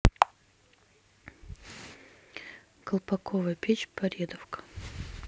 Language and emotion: Russian, neutral